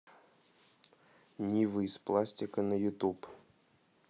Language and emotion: Russian, neutral